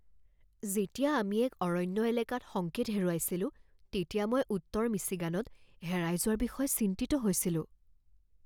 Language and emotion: Assamese, fearful